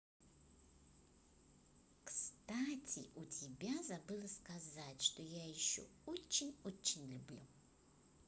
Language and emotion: Russian, positive